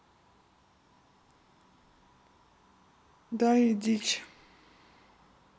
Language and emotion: Russian, neutral